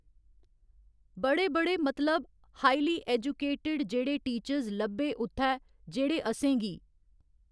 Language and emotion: Dogri, neutral